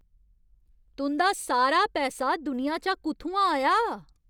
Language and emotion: Dogri, angry